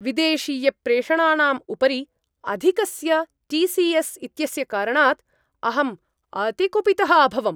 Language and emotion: Sanskrit, angry